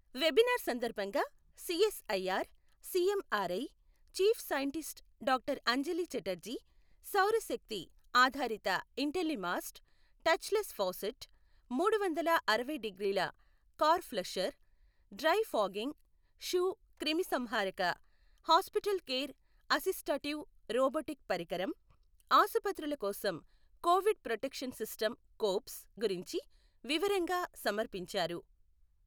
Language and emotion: Telugu, neutral